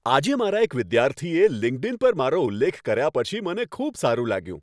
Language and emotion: Gujarati, happy